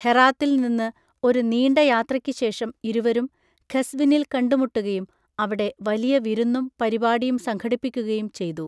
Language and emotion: Malayalam, neutral